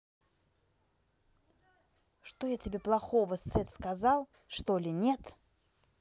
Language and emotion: Russian, angry